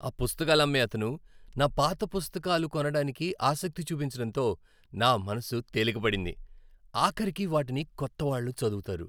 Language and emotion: Telugu, happy